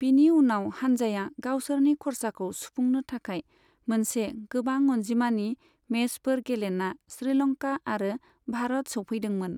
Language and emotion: Bodo, neutral